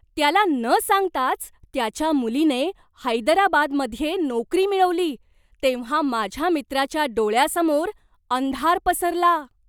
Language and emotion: Marathi, surprised